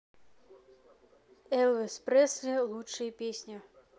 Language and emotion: Russian, neutral